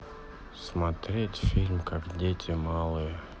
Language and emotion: Russian, sad